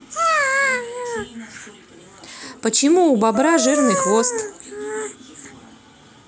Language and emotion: Russian, neutral